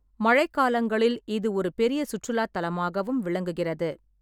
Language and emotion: Tamil, neutral